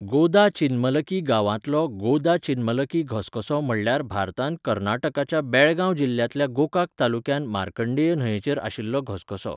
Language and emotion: Goan Konkani, neutral